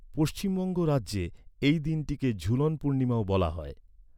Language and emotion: Bengali, neutral